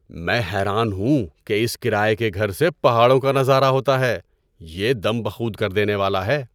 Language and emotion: Urdu, surprised